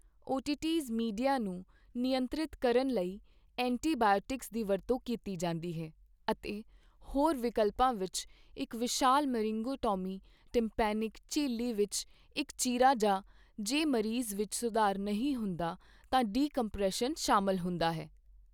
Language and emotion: Punjabi, neutral